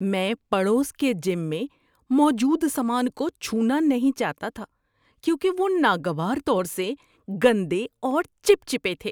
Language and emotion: Urdu, disgusted